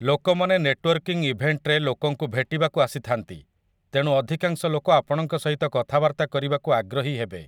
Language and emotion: Odia, neutral